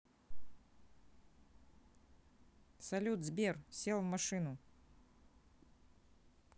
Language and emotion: Russian, neutral